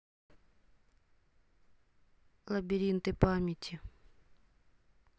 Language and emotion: Russian, sad